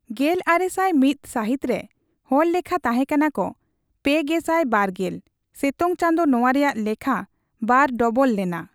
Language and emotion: Santali, neutral